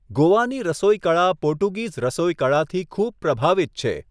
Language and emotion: Gujarati, neutral